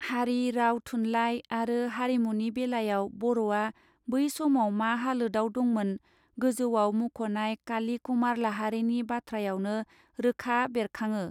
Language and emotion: Bodo, neutral